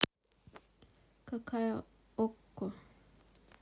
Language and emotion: Russian, neutral